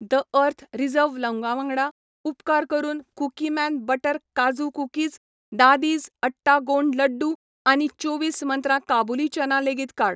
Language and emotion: Goan Konkani, neutral